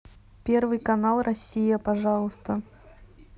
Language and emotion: Russian, neutral